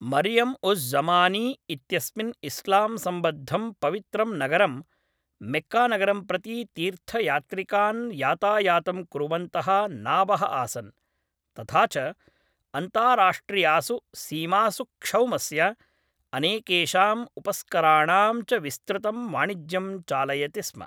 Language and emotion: Sanskrit, neutral